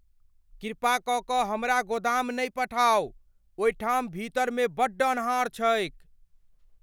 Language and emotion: Maithili, fearful